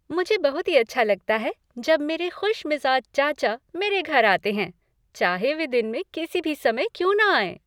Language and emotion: Hindi, happy